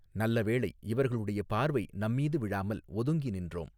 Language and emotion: Tamil, neutral